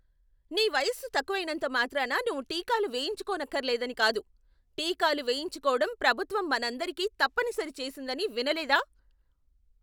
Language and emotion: Telugu, angry